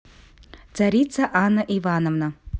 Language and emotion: Russian, neutral